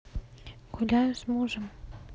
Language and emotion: Russian, neutral